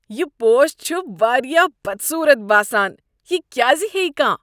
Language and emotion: Kashmiri, disgusted